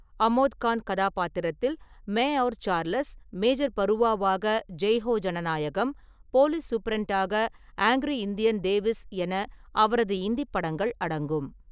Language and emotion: Tamil, neutral